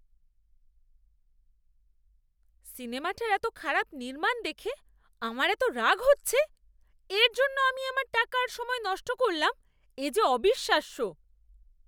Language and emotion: Bengali, angry